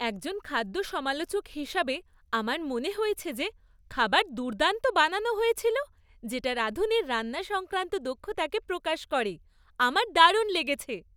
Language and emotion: Bengali, happy